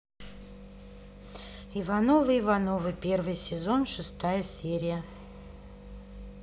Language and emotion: Russian, neutral